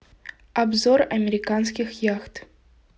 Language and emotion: Russian, neutral